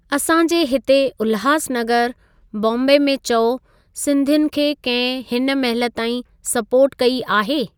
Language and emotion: Sindhi, neutral